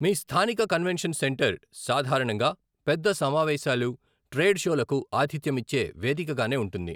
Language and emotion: Telugu, neutral